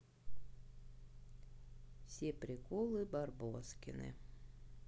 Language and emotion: Russian, neutral